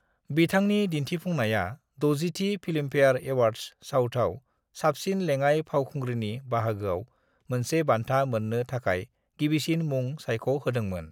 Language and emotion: Bodo, neutral